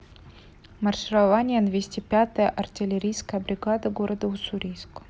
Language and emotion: Russian, neutral